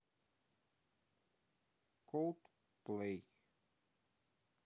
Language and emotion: Russian, neutral